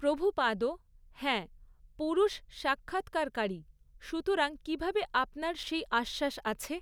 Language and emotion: Bengali, neutral